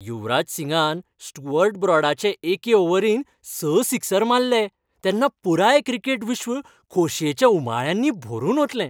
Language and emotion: Goan Konkani, happy